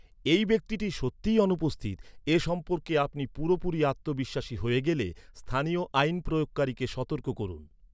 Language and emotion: Bengali, neutral